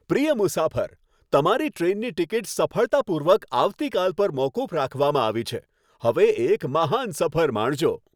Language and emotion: Gujarati, happy